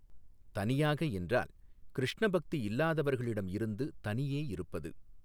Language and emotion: Tamil, neutral